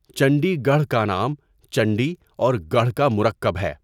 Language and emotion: Urdu, neutral